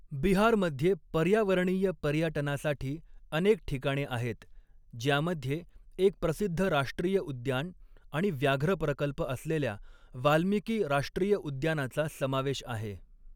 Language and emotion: Marathi, neutral